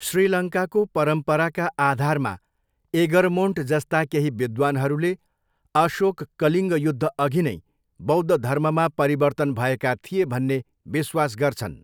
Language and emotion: Nepali, neutral